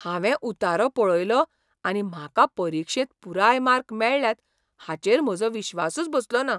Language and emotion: Goan Konkani, surprised